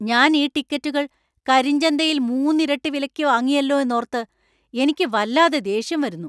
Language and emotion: Malayalam, angry